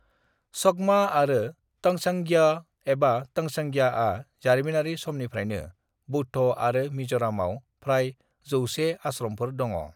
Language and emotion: Bodo, neutral